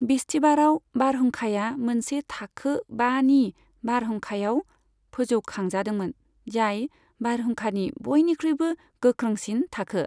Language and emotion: Bodo, neutral